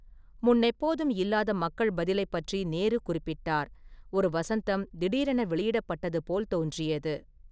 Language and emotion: Tamil, neutral